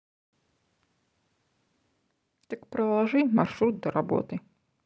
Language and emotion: Russian, neutral